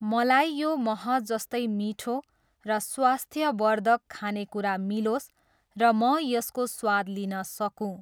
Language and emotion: Nepali, neutral